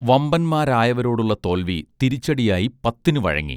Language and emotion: Malayalam, neutral